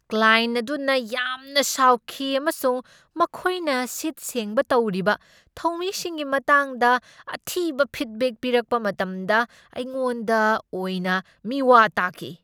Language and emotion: Manipuri, angry